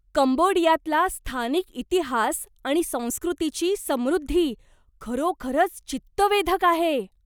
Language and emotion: Marathi, surprised